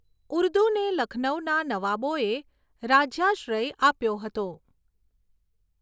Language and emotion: Gujarati, neutral